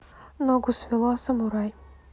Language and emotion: Russian, neutral